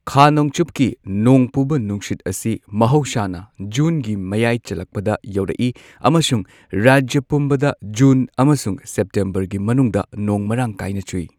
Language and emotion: Manipuri, neutral